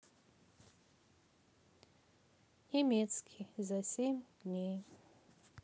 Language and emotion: Russian, sad